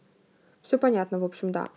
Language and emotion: Russian, neutral